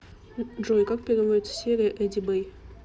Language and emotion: Russian, neutral